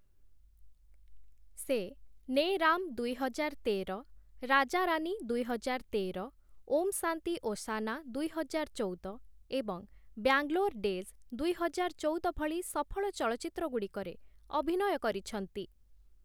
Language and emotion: Odia, neutral